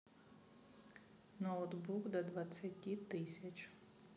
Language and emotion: Russian, neutral